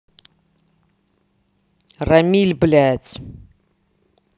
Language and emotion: Russian, angry